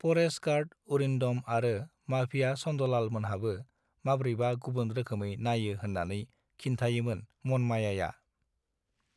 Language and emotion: Bodo, neutral